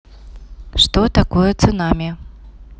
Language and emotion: Russian, neutral